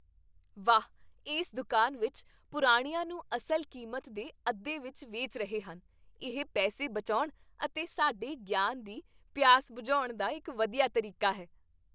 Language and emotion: Punjabi, happy